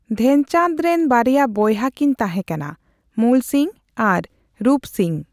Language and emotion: Santali, neutral